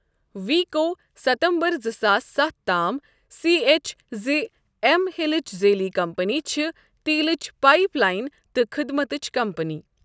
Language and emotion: Kashmiri, neutral